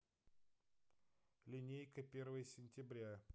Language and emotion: Russian, neutral